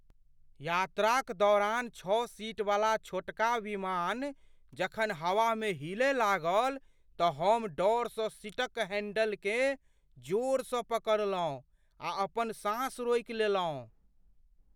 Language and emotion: Maithili, fearful